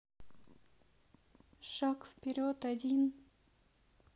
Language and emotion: Russian, sad